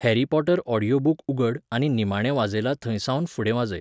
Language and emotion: Goan Konkani, neutral